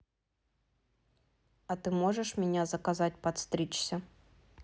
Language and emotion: Russian, neutral